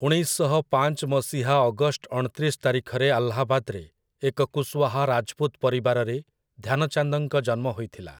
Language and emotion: Odia, neutral